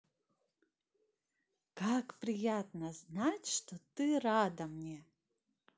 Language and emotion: Russian, positive